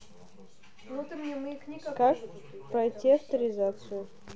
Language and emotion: Russian, neutral